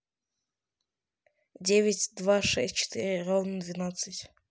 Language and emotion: Russian, neutral